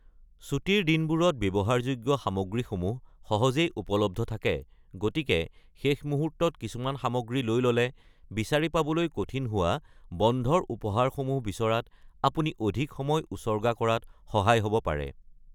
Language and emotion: Assamese, neutral